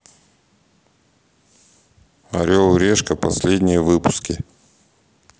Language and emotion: Russian, neutral